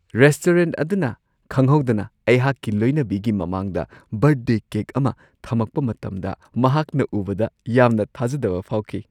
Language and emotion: Manipuri, surprised